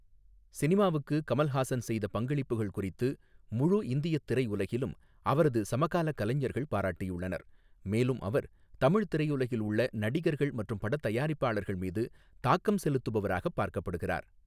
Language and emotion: Tamil, neutral